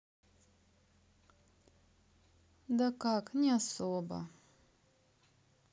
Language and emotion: Russian, sad